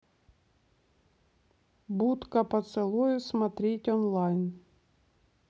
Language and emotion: Russian, neutral